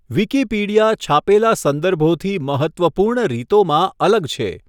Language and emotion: Gujarati, neutral